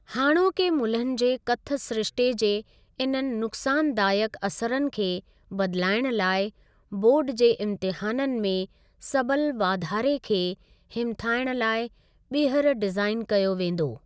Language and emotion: Sindhi, neutral